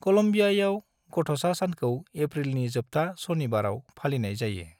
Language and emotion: Bodo, neutral